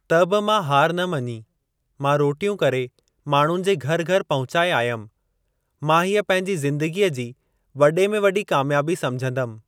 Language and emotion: Sindhi, neutral